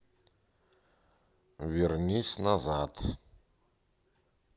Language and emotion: Russian, neutral